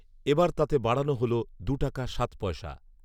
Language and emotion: Bengali, neutral